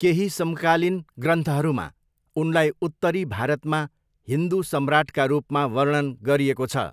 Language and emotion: Nepali, neutral